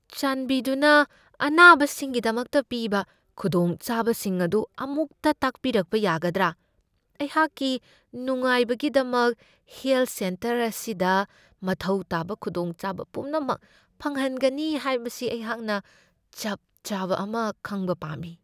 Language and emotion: Manipuri, fearful